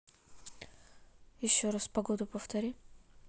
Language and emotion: Russian, neutral